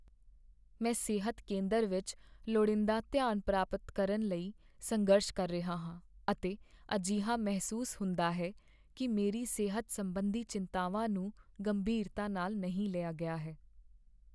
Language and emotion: Punjabi, sad